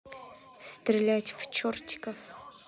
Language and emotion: Russian, neutral